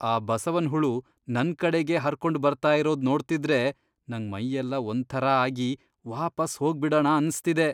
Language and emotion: Kannada, disgusted